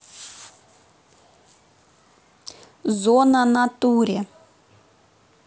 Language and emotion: Russian, neutral